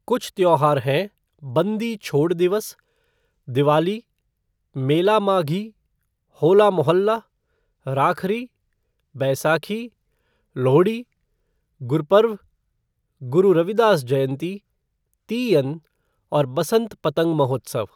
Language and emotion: Hindi, neutral